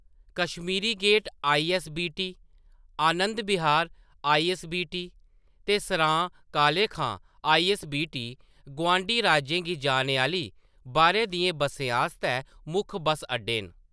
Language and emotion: Dogri, neutral